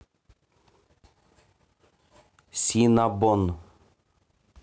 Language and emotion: Russian, neutral